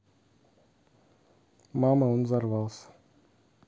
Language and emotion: Russian, neutral